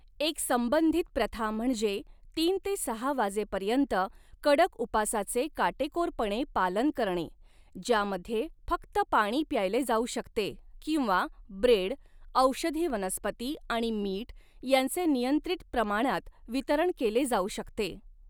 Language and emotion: Marathi, neutral